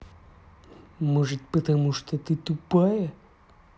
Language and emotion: Russian, angry